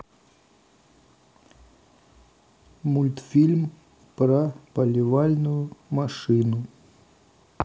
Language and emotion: Russian, neutral